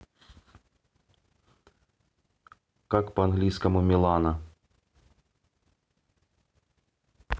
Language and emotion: Russian, neutral